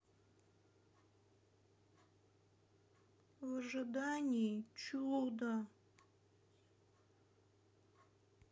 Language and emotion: Russian, sad